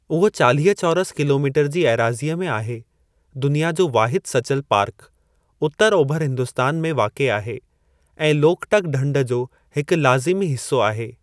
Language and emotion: Sindhi, neutral